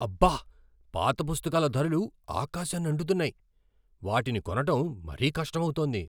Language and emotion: Telugu, surprised